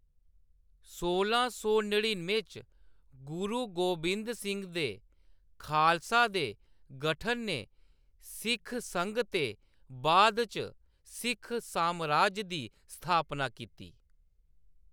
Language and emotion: Dogri, neutral